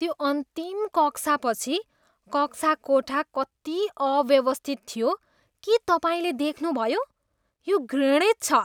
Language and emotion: Nepali, disgusted